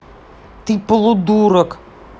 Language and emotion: Russian, angry